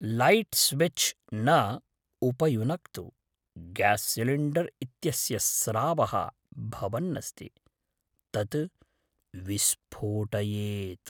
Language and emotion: Sanskrit, fearful